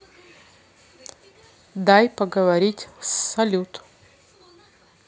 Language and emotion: Russian, neutral